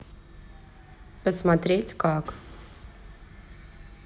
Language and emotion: Russian, neutral